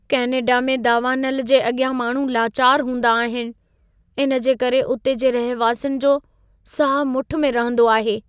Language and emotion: Sindhi, fearful